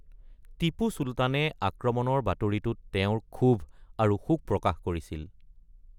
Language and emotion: Assamese, neutral